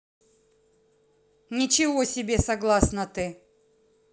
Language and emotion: Russian, angry